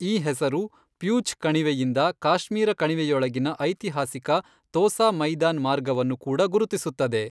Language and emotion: Kannada, neutral